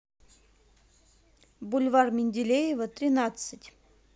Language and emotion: Russian, neutral